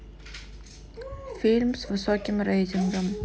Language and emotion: Russian, neutral